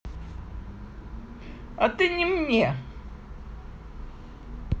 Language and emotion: Russian, sad